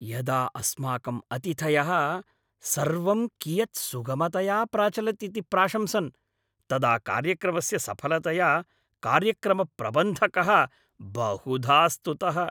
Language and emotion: Sanskrit, happy